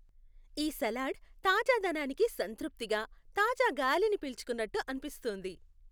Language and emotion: Telugu, happy